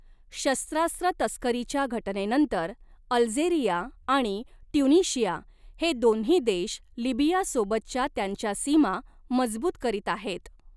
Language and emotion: Marathi, neutral